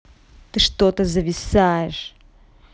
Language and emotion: Russian, angry